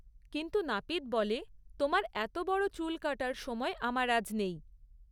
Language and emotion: Bengali, neutral